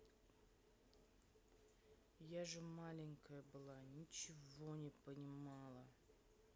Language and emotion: Russian, neutral